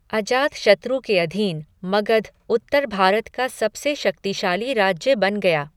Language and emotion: Hindi, neutral